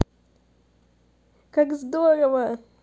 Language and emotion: Russian, positive